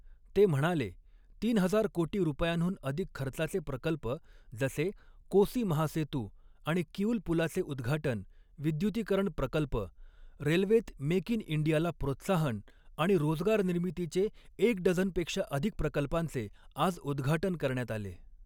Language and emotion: Marathi, neutral